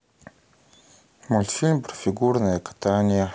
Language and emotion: Russian, sad